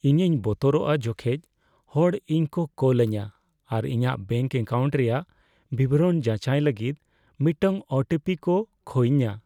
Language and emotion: Santali, fearful